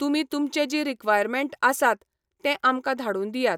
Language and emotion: Goan Konkani, neutral